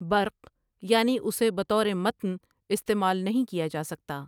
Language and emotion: Urdu, neutral